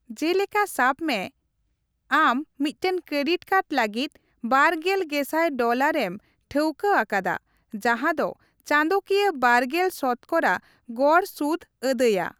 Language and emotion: Santali, neutral